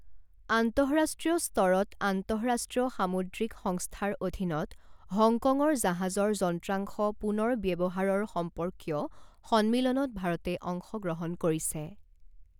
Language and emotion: Assamese, neutral